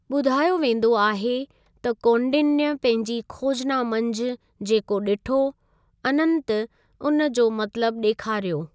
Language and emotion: Sindhi, neutral